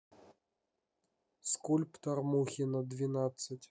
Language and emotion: Russian, neutral